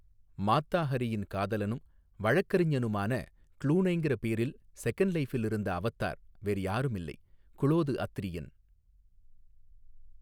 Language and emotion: Tamil, neutral